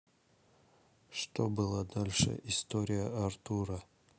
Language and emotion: Russian, neutral